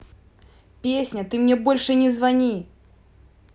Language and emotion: Russian, angry